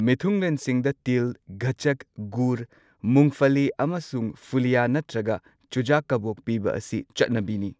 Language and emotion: Manipuri, neutral